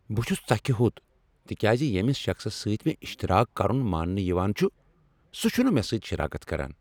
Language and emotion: Kashmiri, angry